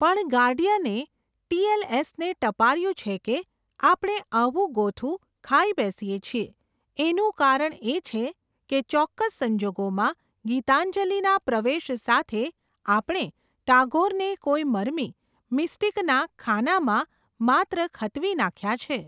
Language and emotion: Gujarati, neutral